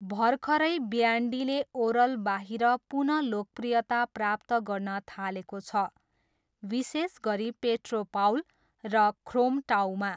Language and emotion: Nepali, neutral